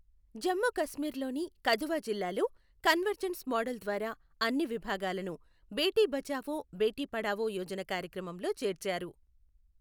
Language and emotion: Telugu, neutral